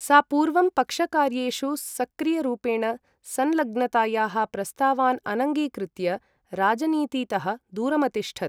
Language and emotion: Sanskrit, neutral